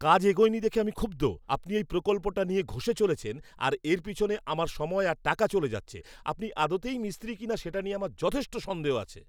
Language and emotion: Bengali, angry